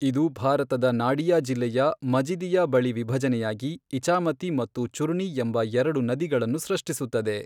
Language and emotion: Kannada, neutral